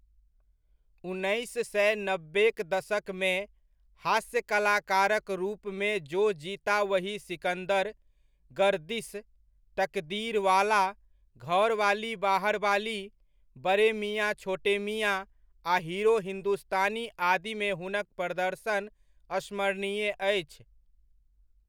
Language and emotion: Maithili, neutral